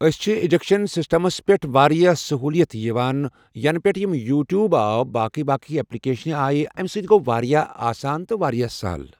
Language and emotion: Kashmiri, neutral